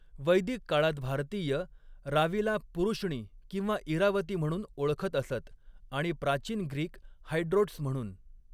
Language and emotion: Marathi, neutral